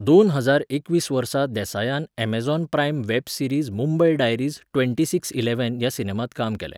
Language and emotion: Goan Konkani, neutral